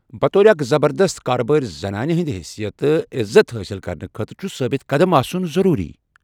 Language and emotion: Kashmiri, neutral